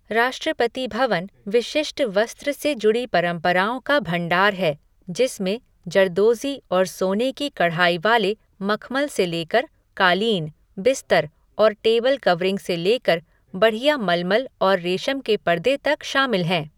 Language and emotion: Hindi, neutral